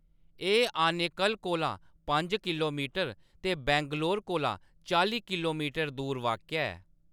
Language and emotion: Dogri, neutral